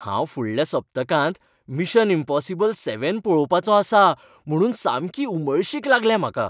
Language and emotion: Goan Konkani, happy